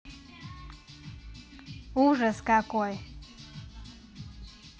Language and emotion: Russian, neutral